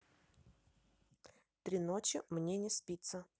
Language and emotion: Russian, neutral